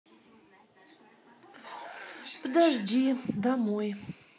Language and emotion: Russian, neutral